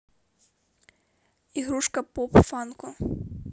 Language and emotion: Russian, neutral